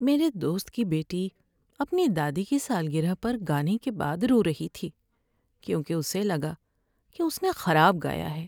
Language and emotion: Urdu, sad